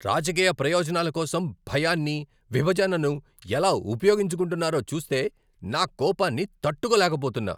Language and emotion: Telugu, angry